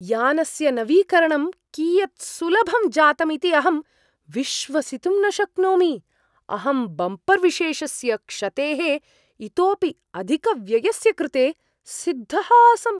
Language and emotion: Sanskrit, surprised